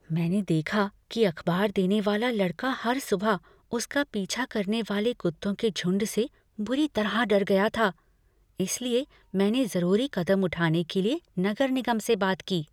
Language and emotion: Hindi, fearful